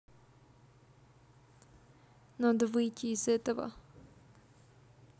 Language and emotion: Russian, neutral